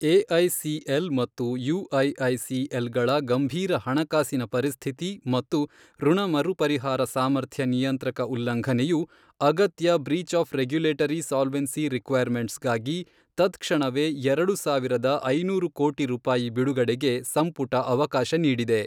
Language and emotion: Kannada, neutral